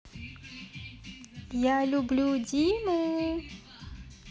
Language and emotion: Russian, positive